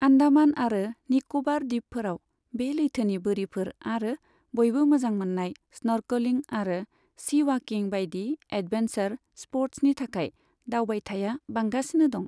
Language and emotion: Bodo, neutral